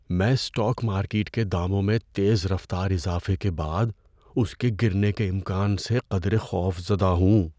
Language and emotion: Urdu, fearful